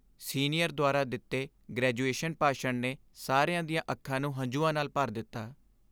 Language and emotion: Punjabi, sad